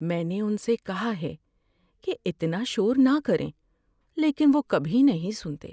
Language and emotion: Urdu, sad